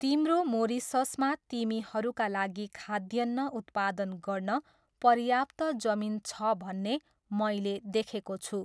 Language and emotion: Nepali, neutral